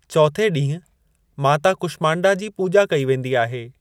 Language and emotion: Sindhi, neutral